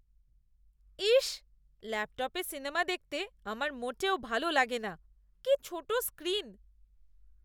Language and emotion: Bengali, disgusted